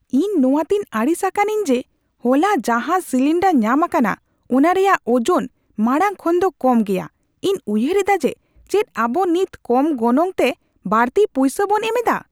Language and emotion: Santali, angry